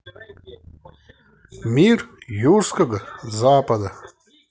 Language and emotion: Russian, neutral